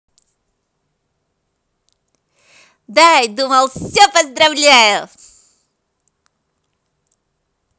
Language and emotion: Russian, positive